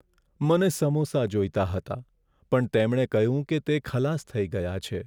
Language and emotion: Gujarati, sad